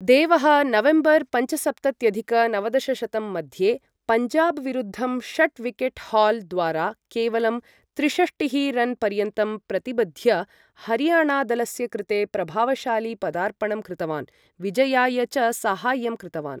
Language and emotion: Sanskrit, neutral